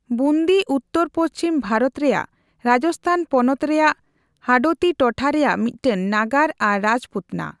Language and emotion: Santali, neutral